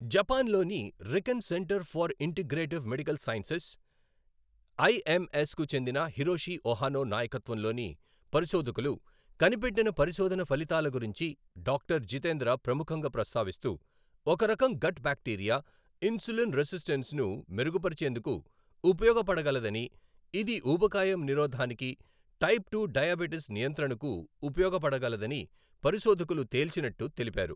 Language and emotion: Telugu, neutral